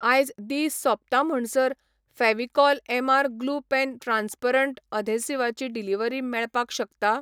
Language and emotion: Goan Konkani, neutral